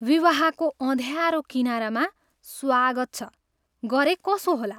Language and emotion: Nepali, disgusted